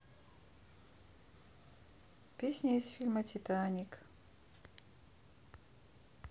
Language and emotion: Russian, neutral